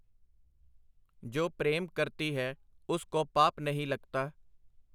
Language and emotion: Punjabi, neutral